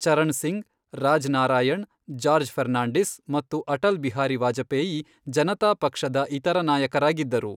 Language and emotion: Kannada, neutral